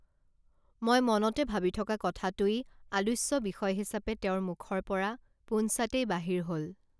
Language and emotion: Assamese, neutral